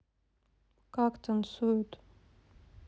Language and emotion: Russian, sad